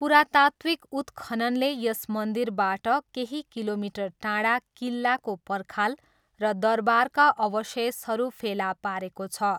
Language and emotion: Nepali, neutral